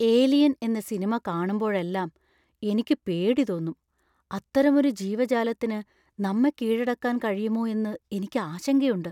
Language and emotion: Malayalam, fearful